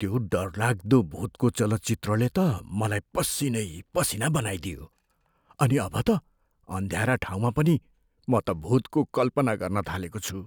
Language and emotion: Nepali, fearful